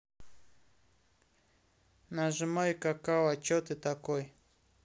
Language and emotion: Russian, neutral